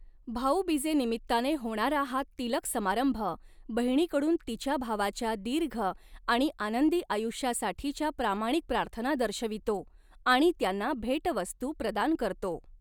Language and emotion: Marathi, neutral